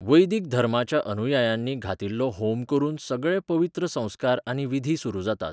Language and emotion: Goan Konkani, neutral